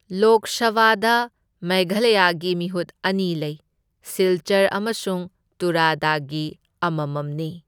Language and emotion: Manipuri, neutral